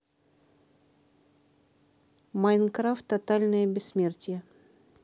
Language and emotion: Russian, neutral